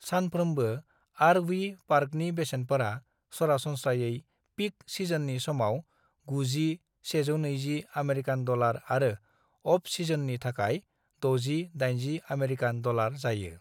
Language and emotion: Bodo, neutral